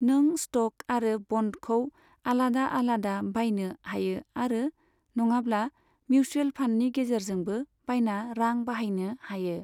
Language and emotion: Bodo, neutral